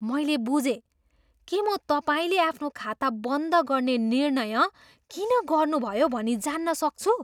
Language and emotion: Nepali, surprised